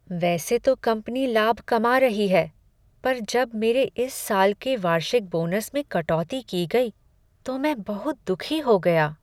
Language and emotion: Hindi, sad